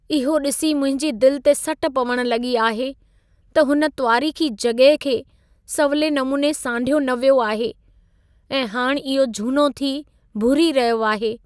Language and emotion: Sindhi, sad